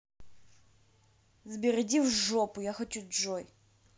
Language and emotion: Russian, angry